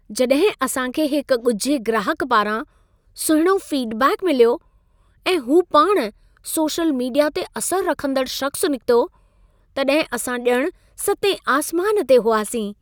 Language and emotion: Sindhi, happy